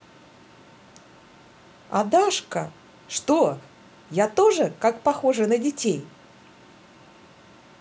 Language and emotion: Russian, positive